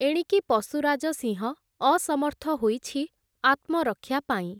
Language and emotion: Odia, neutral